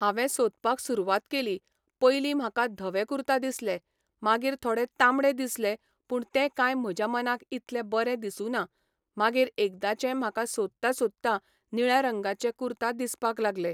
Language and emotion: Goan Konkani, neutral